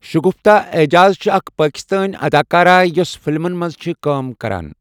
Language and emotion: Kashmiri, neutral